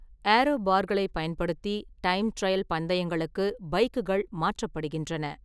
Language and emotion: Tamil, neutral